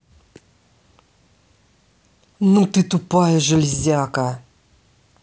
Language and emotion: Russian, angry